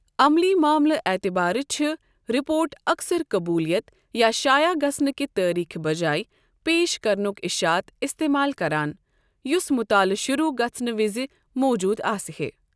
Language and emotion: Kashmiri, neutral